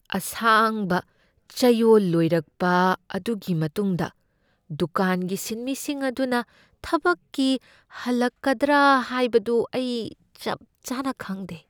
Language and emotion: Manipuri, fearful